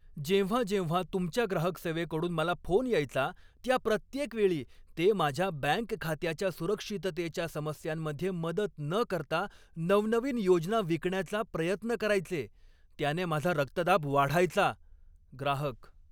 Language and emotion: Marathi, angry